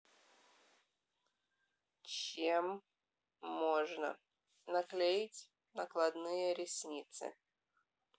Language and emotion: Russian, neutral